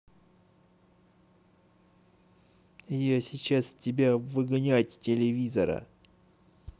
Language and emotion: Russian, angry